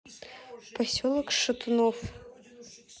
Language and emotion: Russian, neutral